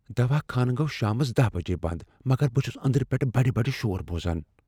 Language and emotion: Kashmiri, fearful